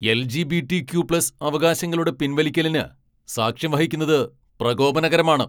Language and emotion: Malayalam, angry